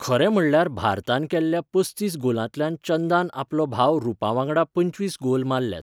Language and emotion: Goan Konkani, neutral